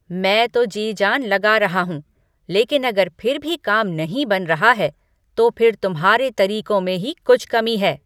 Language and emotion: Hindi, angry